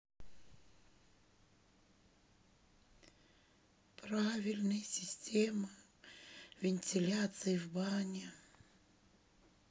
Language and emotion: Russian, sad